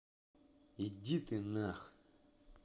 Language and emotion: Russian, angry